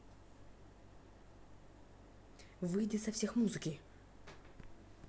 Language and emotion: Russian, angry